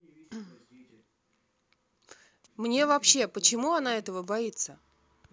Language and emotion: Russian, neutral